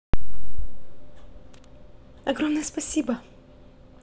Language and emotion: Russian, positive